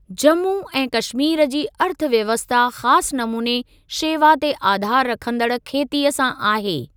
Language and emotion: Sindhi, neutral